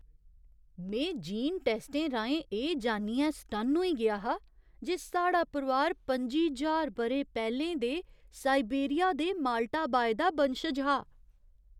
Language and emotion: Dogri, surprised